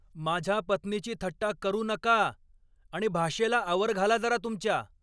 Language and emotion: Marathi, angry